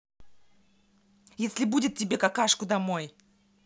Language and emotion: Russian, angry